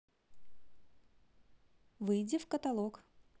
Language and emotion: Russian, positive